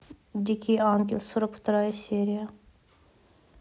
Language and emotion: Russian, neutral